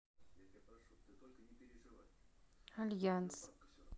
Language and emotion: Russian, neutral